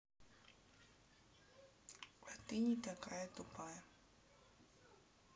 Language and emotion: Russian, neutral